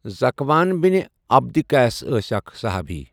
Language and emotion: Kashmiri, neutral